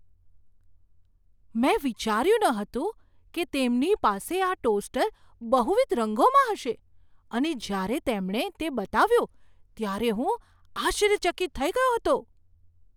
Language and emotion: Gujarati, surprised